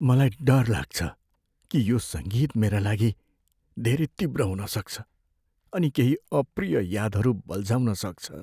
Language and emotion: Nepali, fearful